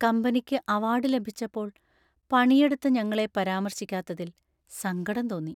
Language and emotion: Malayalam, sad